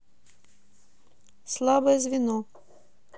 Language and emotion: Russian, neutral